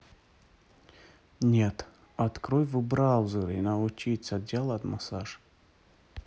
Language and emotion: Russian, neutral